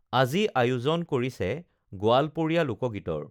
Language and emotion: Assamese, neutral